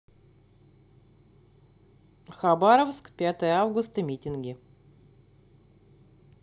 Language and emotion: Russian, neutral